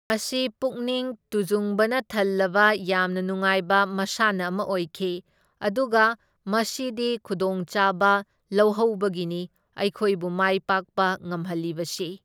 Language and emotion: Manipuri, neutral